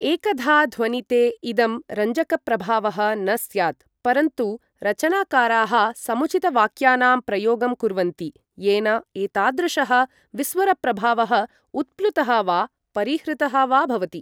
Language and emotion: Sanskrit, neutral